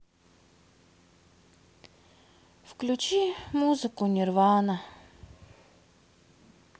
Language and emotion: Russian, sad